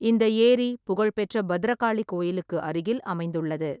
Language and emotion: Tamil, neutral